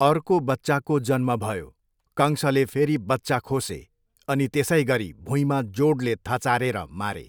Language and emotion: Nepali, neutral